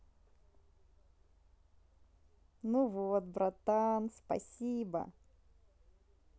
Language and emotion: Russian, positive